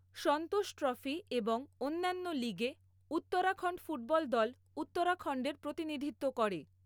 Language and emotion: Bengali, neutral